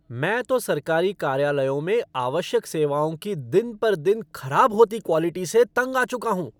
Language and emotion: Hindi, angry